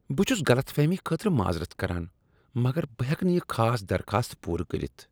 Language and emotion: Kashmiri, disgusted